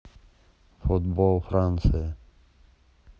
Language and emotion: Russian, neutral